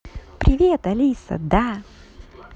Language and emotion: Russian, positive